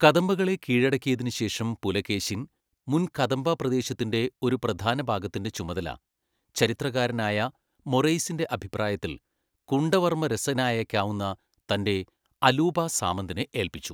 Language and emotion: Malayalam, neutral